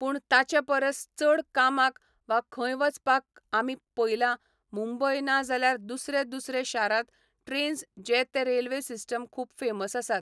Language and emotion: Goan Konkani, neutral